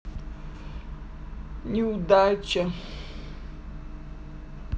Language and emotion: Russian, sad